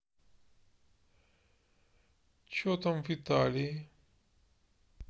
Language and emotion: Russian, sad